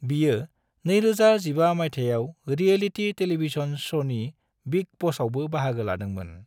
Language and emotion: Bodo, neutral